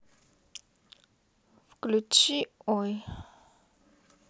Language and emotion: Russian, neutral